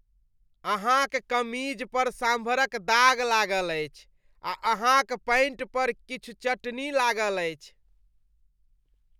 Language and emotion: Maithili, disgusted